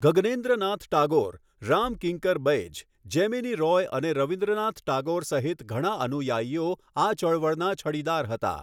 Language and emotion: Gujarati, neutral